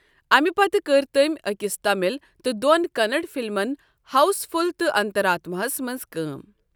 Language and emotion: Kashmiri, neutral